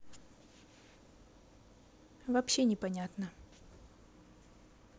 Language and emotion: Russian, neutral